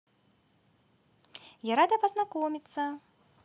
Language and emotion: Russian, positive